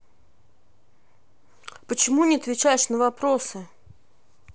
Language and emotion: Russian, angry